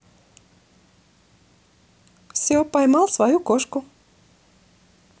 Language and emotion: Russian, positive